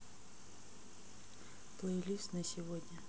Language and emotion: Russian, neutral